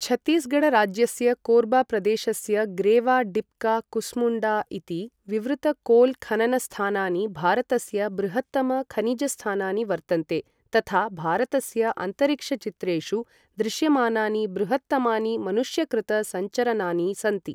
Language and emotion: Sanskrit, neutral